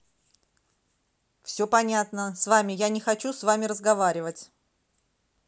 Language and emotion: Russian, angry